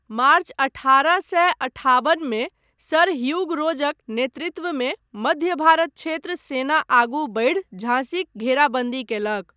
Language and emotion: Maithili, neutral